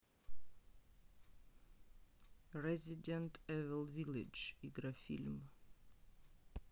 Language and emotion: Russian, neutral